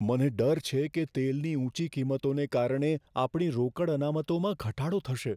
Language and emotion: Gujarati, fearful